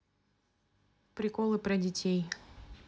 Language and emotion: Russian, neutral